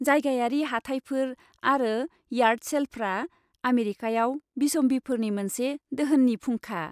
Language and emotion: Bodo, happy